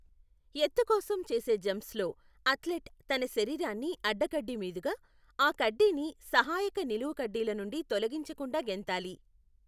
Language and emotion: Telugu, neutral